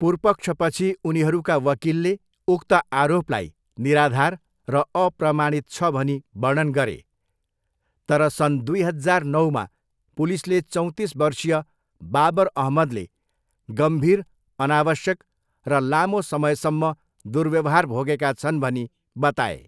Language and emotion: Nepali, neutral